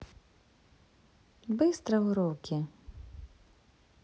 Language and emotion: Russian, neutral